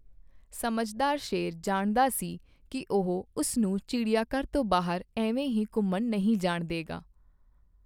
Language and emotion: Punjabi, neutral